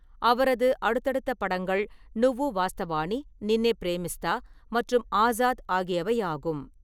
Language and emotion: Tamil, neutral